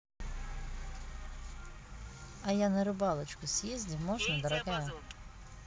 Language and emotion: Russian, neutral